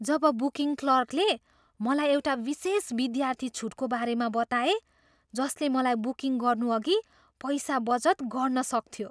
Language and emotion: Nepali, surprised